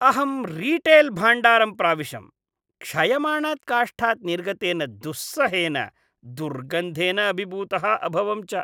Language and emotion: Sanskrit, disgusted